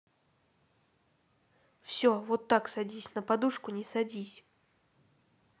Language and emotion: Russian, neutral